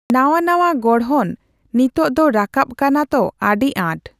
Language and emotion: Santali, neutral